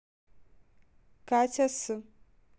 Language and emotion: Russian, neutral